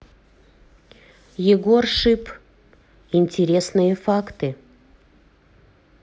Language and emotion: Russian, neutral